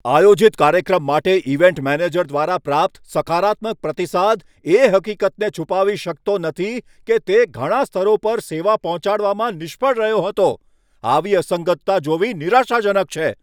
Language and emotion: Gujarati, angry